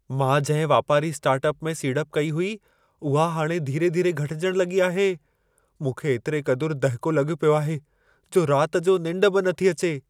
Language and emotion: Sindhi, fearful